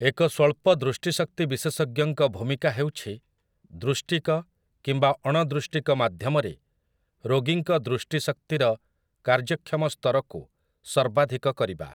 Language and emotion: Odia, neutral